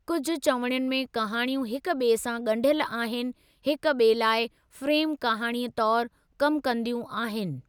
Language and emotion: Sindhi, neutral